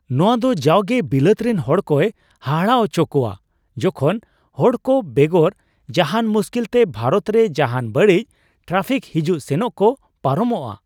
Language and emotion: Santali, surprised